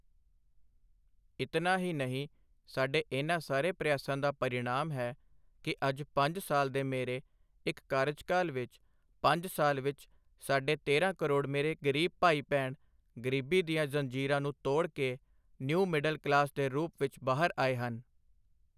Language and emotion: Punjabi, neutral